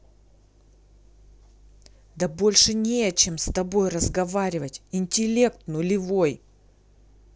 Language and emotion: Russian, angry